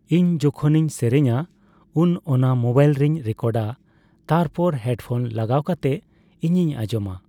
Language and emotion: Santali, neutral